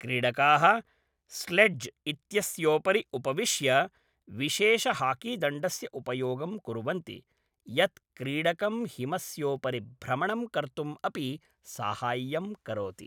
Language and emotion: Sanskrit, neutral